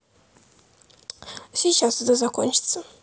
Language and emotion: Russian, neutral